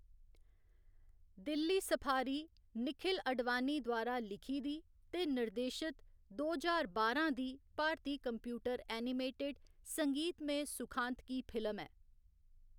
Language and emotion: Dogri, neutral